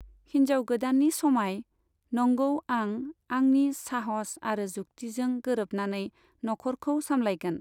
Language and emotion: Bodo, neutral